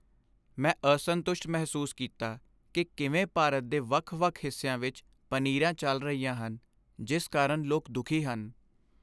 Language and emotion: Punjabi, sad